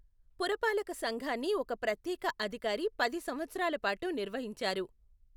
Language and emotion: Telugu, neutral